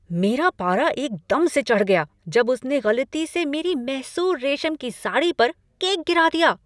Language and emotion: Hindi, angry